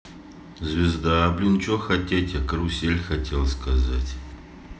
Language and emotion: Russian, neutral